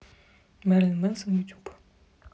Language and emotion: Russian, neutral